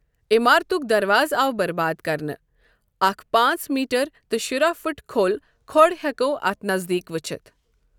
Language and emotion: Kashmiri, neutral